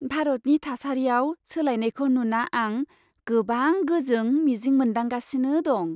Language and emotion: Bodo, happy